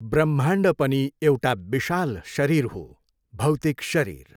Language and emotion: Nepali, neutral